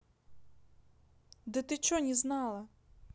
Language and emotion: Russian, neutral